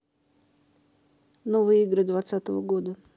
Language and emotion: Russian, neutral